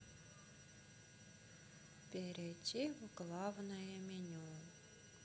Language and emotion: Russian, sad